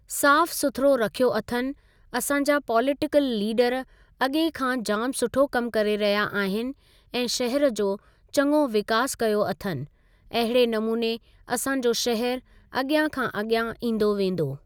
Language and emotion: Sindhi, neutral